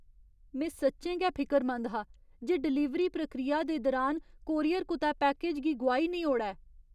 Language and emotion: Dogri, fearful